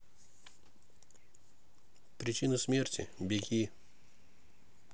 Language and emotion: Russian, neutral